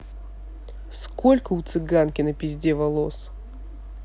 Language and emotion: Russian, neutral